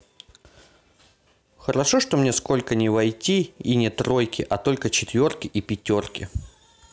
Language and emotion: Russian, neutral